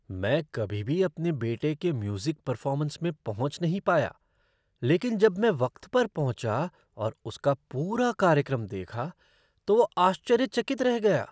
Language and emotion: Hindi, surprised